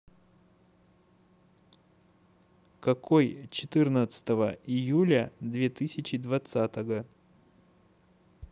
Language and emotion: Russian, neutral